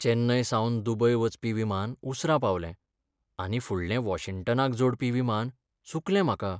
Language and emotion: Goan Konkani, sad